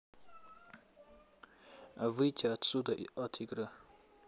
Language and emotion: Russian, neutral